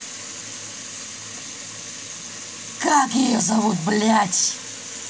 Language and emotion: Russian, angry